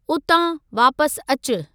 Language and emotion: Sindhi, neutral